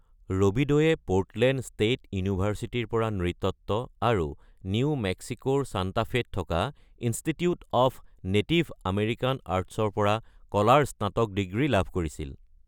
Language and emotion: Assamese, neutral